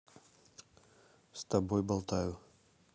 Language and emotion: Russian, neutral